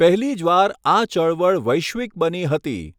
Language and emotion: Gujarati, neutral